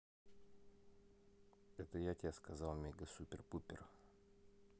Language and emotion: Russian, neutral